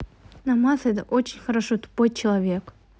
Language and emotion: Russian, neutral